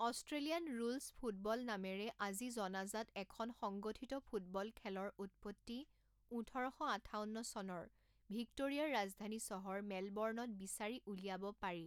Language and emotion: Assamese, neutral